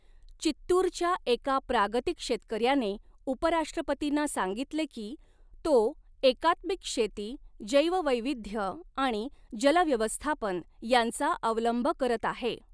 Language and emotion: Marathi, neutral